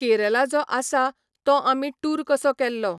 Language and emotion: Goan Konkani, neutral